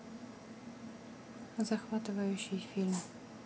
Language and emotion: Russian, neutral